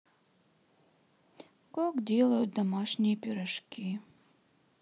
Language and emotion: Russian, sad